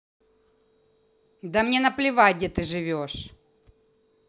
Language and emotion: Russian, angry